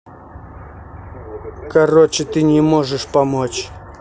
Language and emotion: Russian, angry